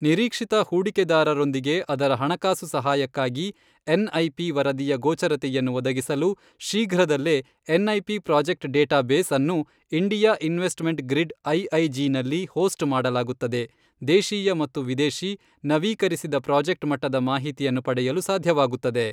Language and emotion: Kannada, neutral